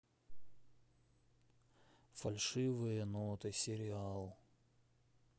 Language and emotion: Russian, sad